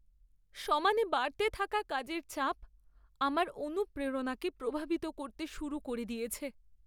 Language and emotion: Bengali, sad